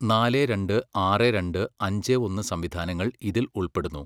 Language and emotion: Malayalam, neutral